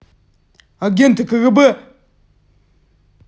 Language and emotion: Russian, angry